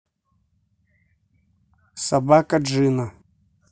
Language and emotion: Russian, neutral